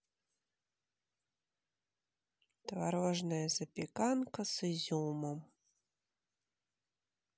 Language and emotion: Russian, sad